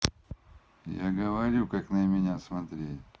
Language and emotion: Russian, neutral